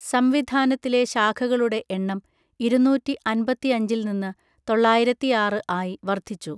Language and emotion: Malayalam, neutral